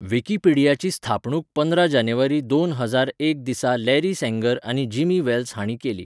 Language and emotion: Goan Konkani, neutral